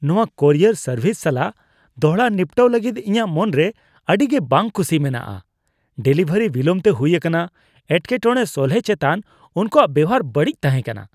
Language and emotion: Santali, disgusted